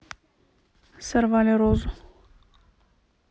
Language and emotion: Russian, neutral